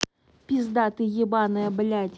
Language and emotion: Russian, angry